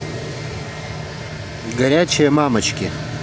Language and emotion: Russian, neutral